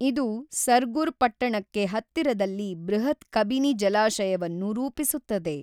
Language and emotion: Kannada, neutral